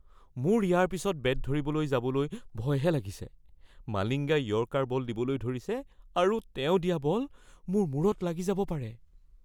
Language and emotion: Assamese, fearful